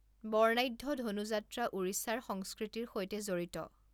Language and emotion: Assamese, neutral